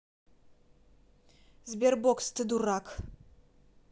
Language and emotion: Russian, angry